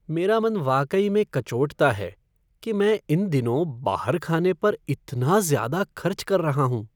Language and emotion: Hindi, sad